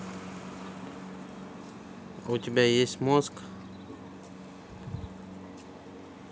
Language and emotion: Russian, neutral